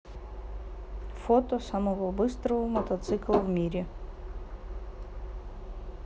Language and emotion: Russian, neutral